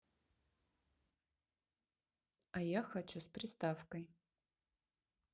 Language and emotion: Russian, neutral